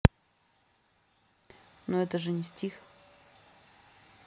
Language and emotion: Russian, neutral